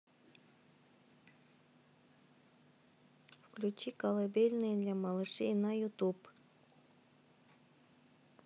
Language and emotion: Russian, neutral